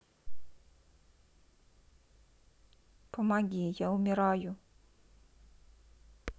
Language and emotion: Russian, sad